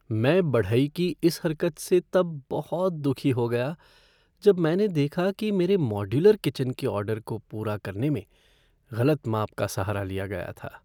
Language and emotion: Hindi, sad